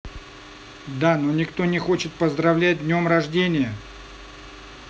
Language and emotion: Russian, neutral